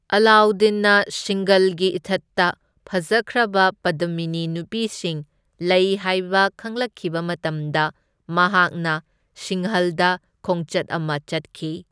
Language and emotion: Manipuri, neutral